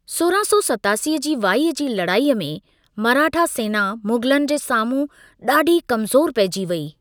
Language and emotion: Sindhi, neutral